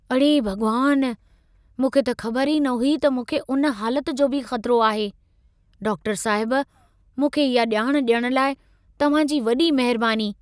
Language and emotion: Sindhi, surprised